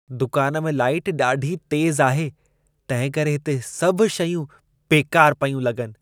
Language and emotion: Sindhi, disgusted